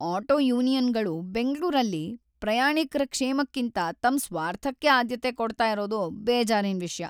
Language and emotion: Kannada, sad